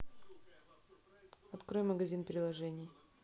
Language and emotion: Russian, neutral